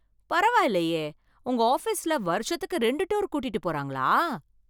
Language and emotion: Tamil, surprised